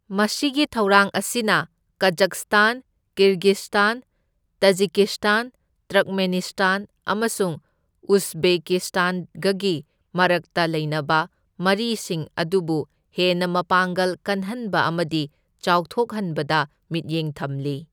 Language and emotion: Manipuri, neutral